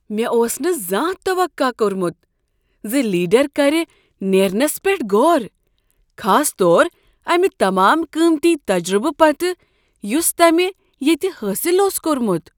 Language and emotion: Kashmiri, surprised